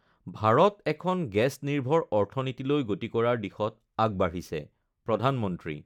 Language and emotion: Assamese, neutral